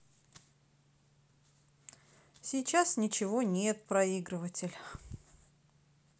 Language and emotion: Russian, sad